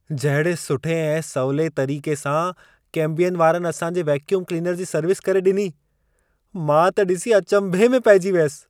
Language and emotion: Sindhi, surprised